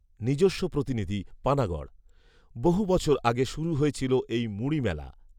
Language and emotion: Bengali, neutral